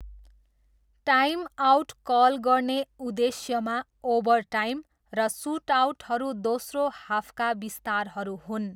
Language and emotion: Nepali, neutral